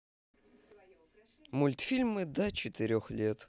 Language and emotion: Russian, neutral